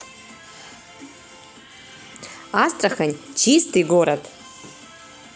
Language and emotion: Russian, positive